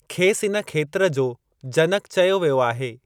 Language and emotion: Sindhi, neutral